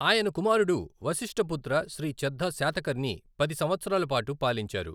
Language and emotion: Telugu, neutral